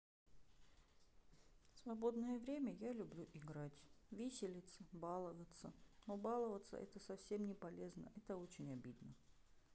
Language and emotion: Russian, sad